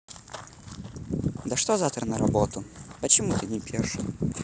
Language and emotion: Russian, neutral